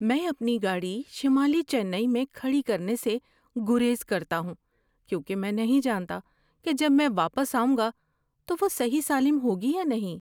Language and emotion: Urdu, fearful